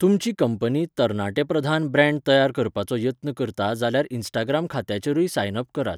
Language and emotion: Goan Konkani, neutral